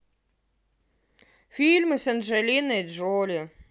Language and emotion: Russian, neutral